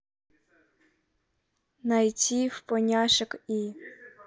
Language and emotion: Russian, neutral